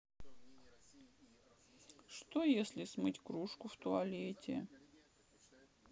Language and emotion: Russian, sad